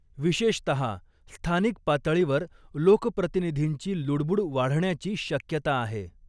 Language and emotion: Marathi, neutral